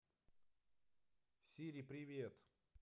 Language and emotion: Russian, positive